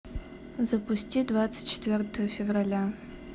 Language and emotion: Russian, neutral